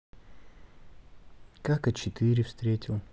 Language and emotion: Russian, neutral